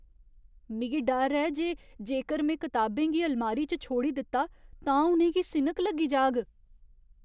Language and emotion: Dogri, fearful